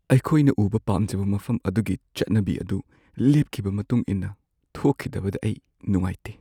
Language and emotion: Manipuri, sad